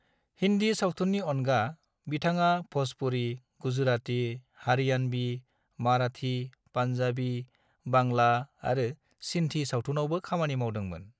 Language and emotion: Bodo, neutral